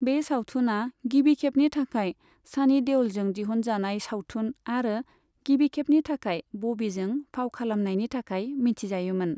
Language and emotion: Bodo, neutral